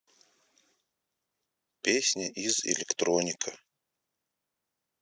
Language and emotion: Russian, neutral